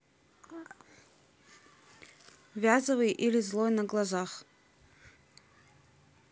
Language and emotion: Russian, neutral